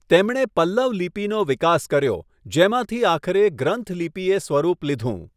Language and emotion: Gujarati, neutral